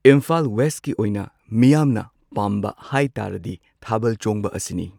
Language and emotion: Manipuri, neutral